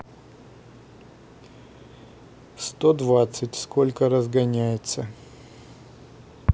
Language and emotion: Russian, neutral